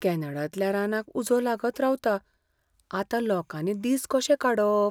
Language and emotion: Goan Konkani, fearful